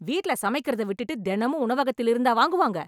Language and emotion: Tamil, angry